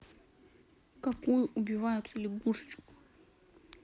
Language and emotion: Russian, sad